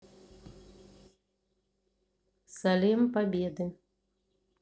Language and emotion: Russian, neutral